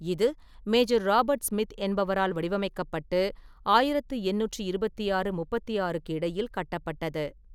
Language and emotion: Tamil, neutral